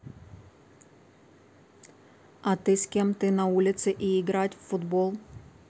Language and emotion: Russian, neutral